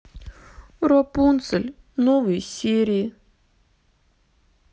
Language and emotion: Russian, sad